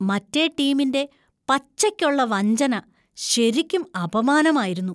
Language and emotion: Malayalam, disgusted